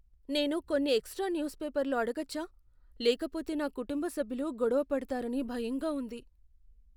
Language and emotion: Telugu, fearful